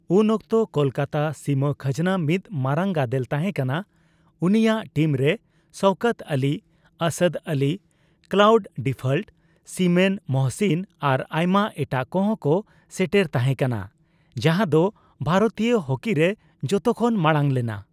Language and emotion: Santali, neutral